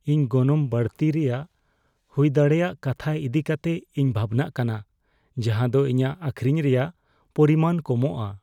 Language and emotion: Santali, fearful